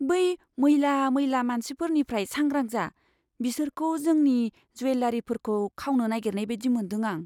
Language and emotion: Bodo, fearful